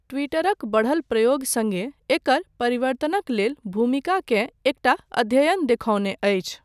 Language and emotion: Maithili, neutral